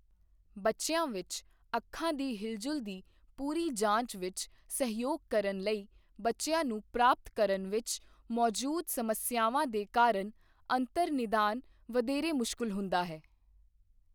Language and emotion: Punjabi, neutral